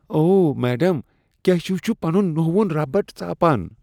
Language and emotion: Kashmiri, disgusted